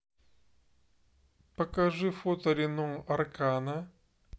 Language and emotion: Russian, neutral